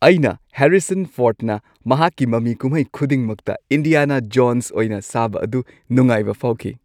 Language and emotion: Manipuri, happy